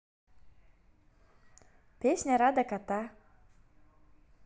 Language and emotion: Russian, positive